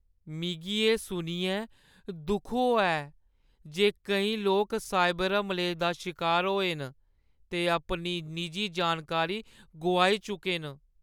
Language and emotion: Dogri, sad